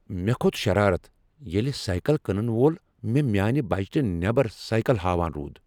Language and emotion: Kashmiri, angry